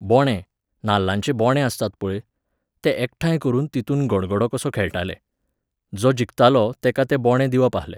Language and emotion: Goan Konkani, neutral